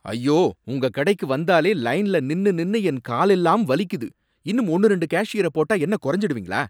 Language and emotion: Tamil, angry